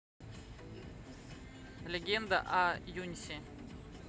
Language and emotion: Russian, neutral